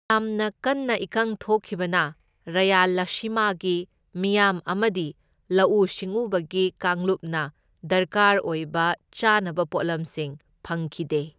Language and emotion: Manipuri, neutral